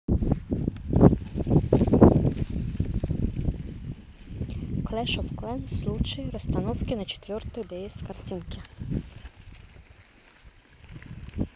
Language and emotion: Russian, neutral